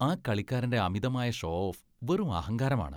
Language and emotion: Malayalam, disgusted